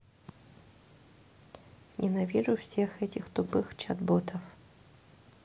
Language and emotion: Russian, neutral